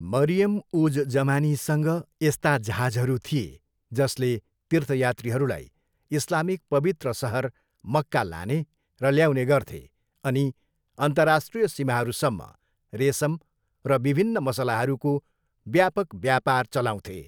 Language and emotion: Nepali, neutral